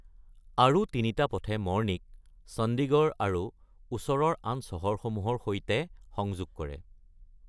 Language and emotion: Assamese, neutral